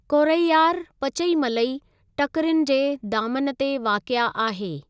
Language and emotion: Sindhi, neutral